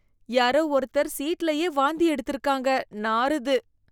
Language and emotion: Tamil, disgusted